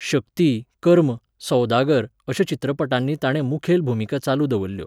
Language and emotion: Goan Konkani, neutral